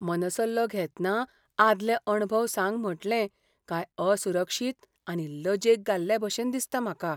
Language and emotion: Goan Konkani, fearful